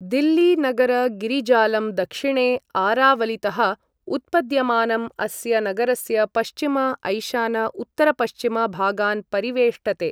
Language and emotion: Sanskrit, neutral